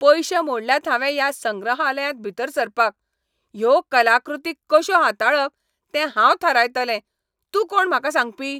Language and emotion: Goan Konkani, angry